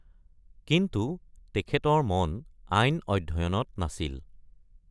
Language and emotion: Assamese, neutral